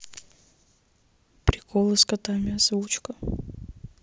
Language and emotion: Russian, neutral